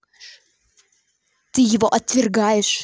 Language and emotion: Russian, angry